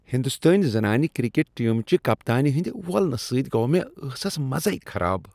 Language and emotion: Kashmiri, disgusted